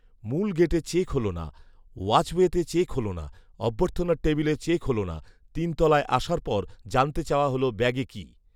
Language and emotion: Bengali, neutral